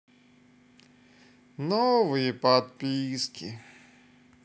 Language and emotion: Russian, sad